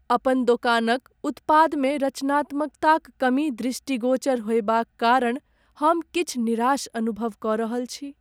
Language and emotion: Maithili, sad